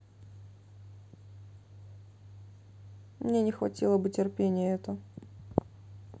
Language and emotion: Russian, sad